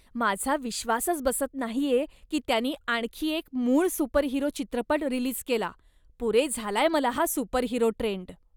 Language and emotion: Marathi, disgusted